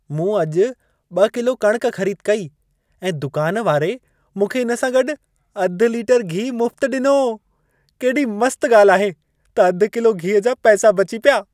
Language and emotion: Sindhi, happy